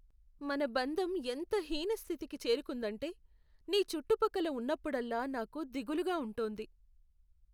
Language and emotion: Telugu, sad